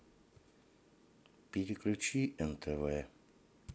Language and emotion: Russian, sad